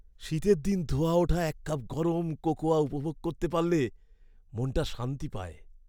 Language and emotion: Bengali, happy